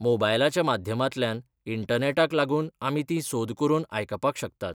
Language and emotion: Goan Konkani, neutral